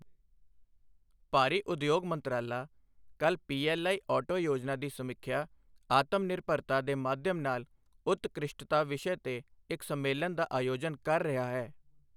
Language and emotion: Punjabi, neutral